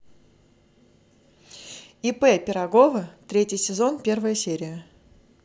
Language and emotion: Russian, positive